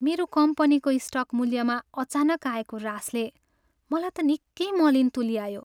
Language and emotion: Nepali, sad